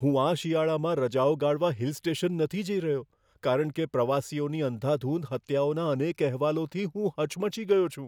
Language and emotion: Gujarati, fearful